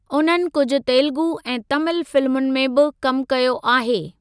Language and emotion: Sindhi, neutral